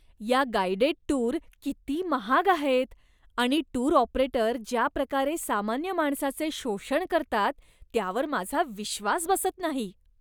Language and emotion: Marathi, disgusted